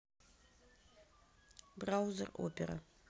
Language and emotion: Russian, neutral